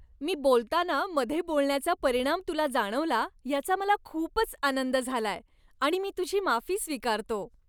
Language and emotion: Marathi, happy